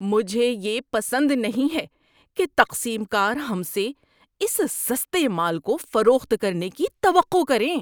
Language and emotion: Urdu, disgusted